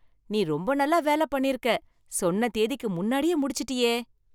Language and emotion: Tamil, happy